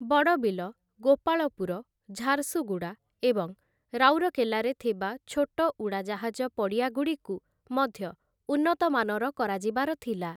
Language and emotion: Odia, neutral